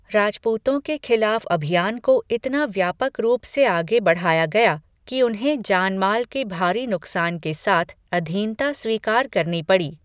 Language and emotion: Hindi, neutral